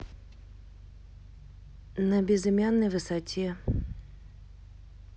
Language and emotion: Russian, neutral